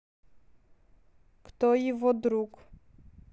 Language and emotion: Russian, neutral